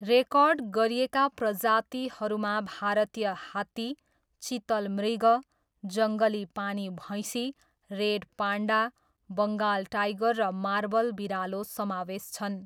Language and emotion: Nepali, neutral